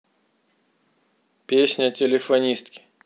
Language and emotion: Russian, neutral